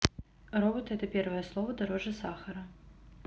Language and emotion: Russian, neutral